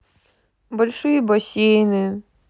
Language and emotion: Russian, sad